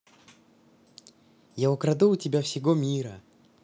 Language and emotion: Russian, positive